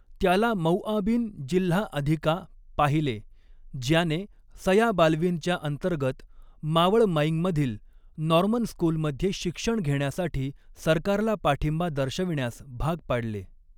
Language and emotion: Marathi, neutral